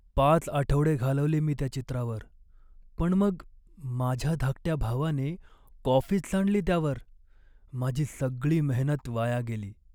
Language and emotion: Marathi, sad